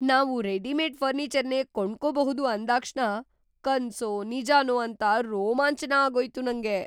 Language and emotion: Kannada, surprised